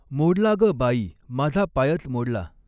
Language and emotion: Marathi, neutral